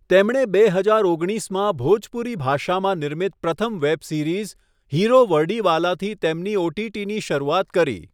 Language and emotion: Gujarati, neutral